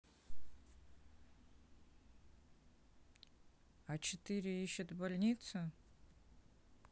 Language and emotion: Russian, neutral